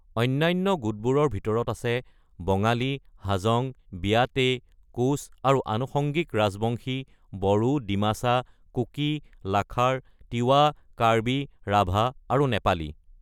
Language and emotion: Assamese, neutral